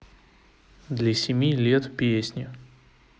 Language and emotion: Russian, neutral